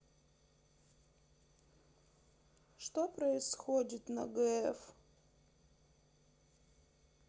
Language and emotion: Russian, sad